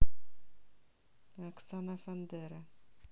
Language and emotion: Russian, neutral